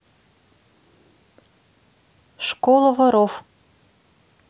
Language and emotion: Russian, neutral